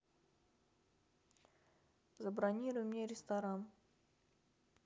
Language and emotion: Russian, neutral